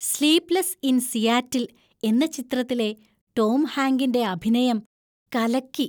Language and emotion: Malayalam, happy